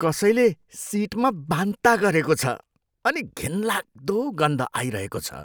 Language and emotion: Nepali, disgusted